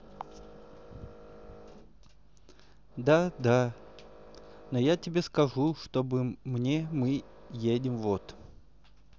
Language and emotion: Russian, neutral